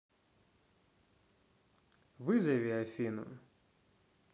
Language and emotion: Russian, neutral